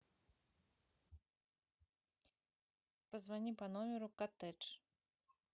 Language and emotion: Russian, neutral